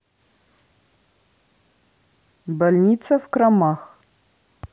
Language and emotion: Russian, neutral